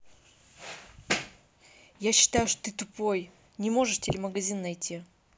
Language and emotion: Russian, angry